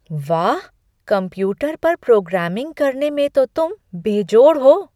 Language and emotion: Hindi, surprised